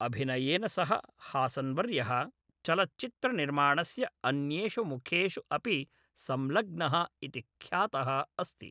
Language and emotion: Sanskrit, neutral